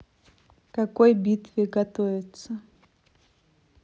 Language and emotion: Russian, neutral